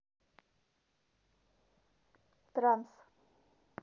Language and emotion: Russian, neutral